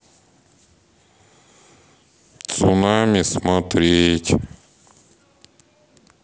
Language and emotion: Russian, sad